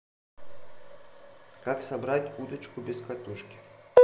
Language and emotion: Russian, neutral